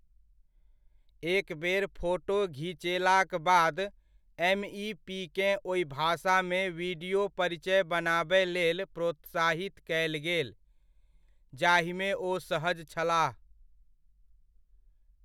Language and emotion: Maithili, neutral